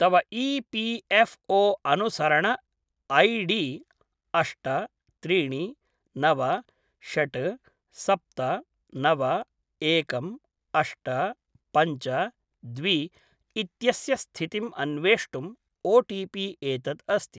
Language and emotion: Sanskrit, neutral